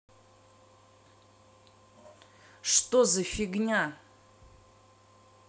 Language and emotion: Russian, angry